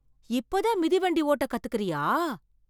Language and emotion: Tamil, surprised